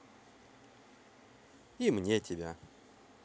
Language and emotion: Russian, neutral